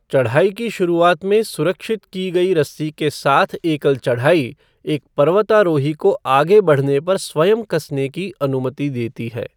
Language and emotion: Hindi, neutral